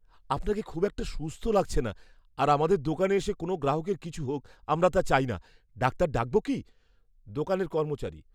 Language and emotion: Bengali, fearful